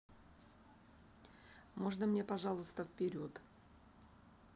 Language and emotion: Russian, neutral